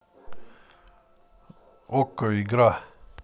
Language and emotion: Russian, neutral